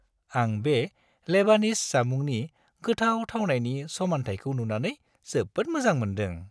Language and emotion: Bodo, happy